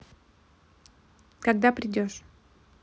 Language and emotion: Russian, neutral